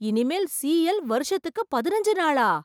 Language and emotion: Tamil, surprised